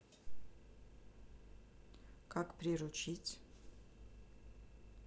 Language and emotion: Russian, neutral